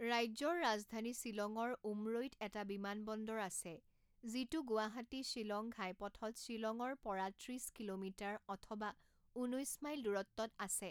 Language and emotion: Assamese, neutral